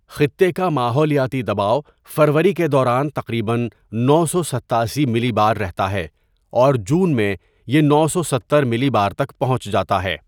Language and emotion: Urdu, neutral